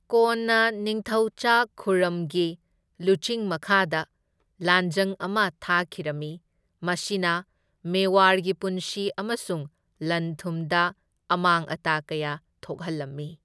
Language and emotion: Manipuri, neutral